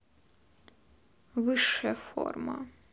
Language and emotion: Russian, neutral